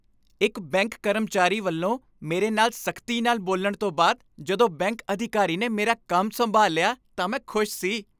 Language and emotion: Punjabi, happy